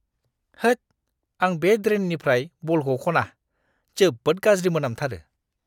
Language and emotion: Bodo, disgusted